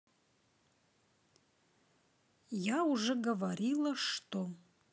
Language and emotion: Russian, neutral